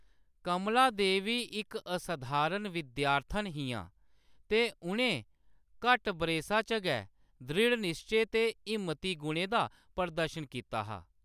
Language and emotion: Dogri, neutral